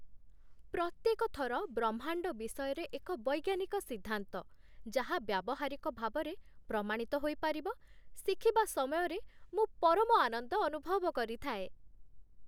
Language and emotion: Odia, happy